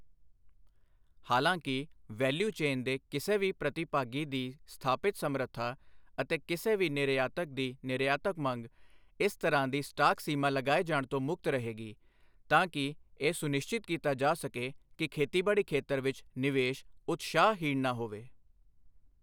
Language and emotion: Punjabi, neutral